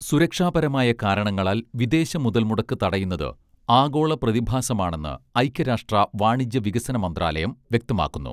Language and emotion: Malayalam, neutral